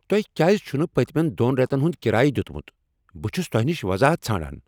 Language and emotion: Kashmiri, angry